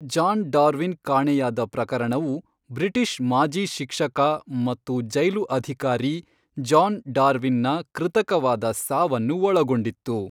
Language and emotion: Kannada, neutral